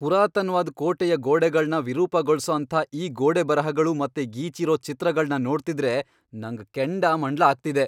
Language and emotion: Kannada, angry